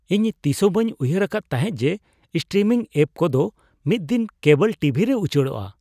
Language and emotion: Santali, surprised